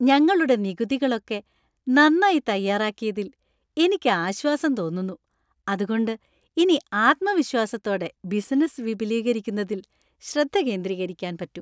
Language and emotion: Malayalam, happy